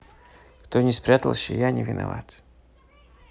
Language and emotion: Russian, neutral